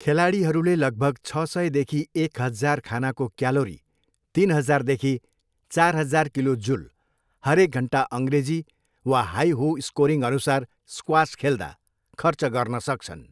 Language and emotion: Nepali, neutral